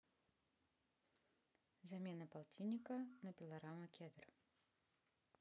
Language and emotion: Russian, neutral